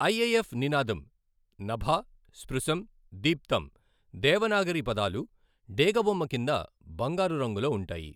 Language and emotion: Telugu, neutral